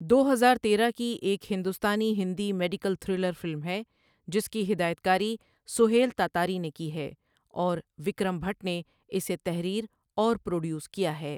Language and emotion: Urdu, neutral